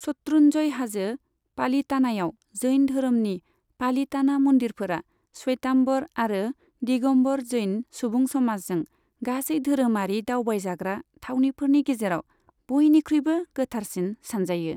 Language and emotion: Bodo, neutral